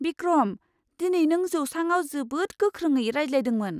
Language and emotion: Bodo, surprised